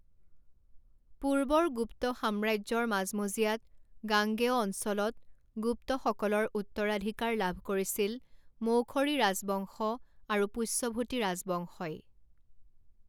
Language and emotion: Assamese, neutral